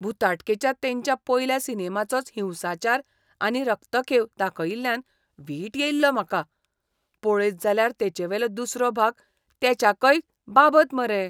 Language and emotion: Goan Konkani, disgusted